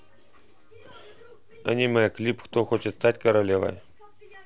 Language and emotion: Russian, neutral